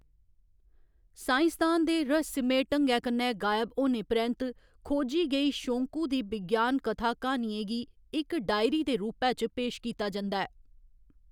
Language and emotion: Dogri, neutral